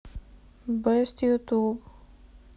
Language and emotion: Russian, sad